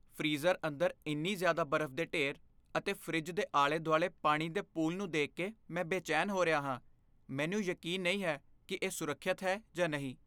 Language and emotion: Punjabi, fearful